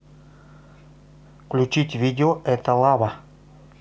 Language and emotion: Russian, neutral